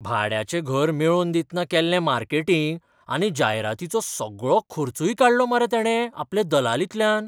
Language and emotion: Goan Konkani, surprised